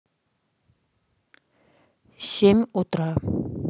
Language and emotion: Russian, neutral